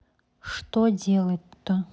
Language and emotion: Russian, neutral